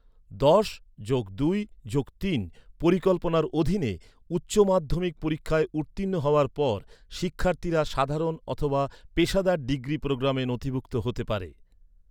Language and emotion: Bengali, neutral